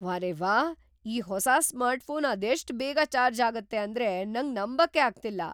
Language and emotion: Kannada, surprised